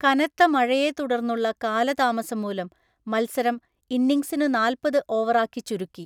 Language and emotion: Malayalam, neutral